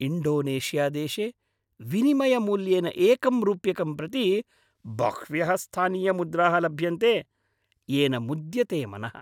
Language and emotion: Sanskrit, happy